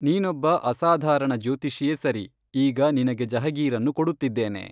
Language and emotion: Kannada, neutral